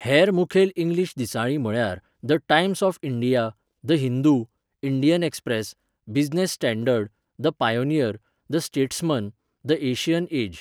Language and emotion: Goan Konkani, neutral